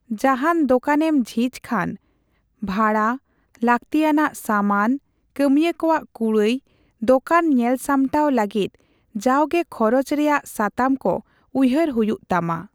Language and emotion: Santali, neutral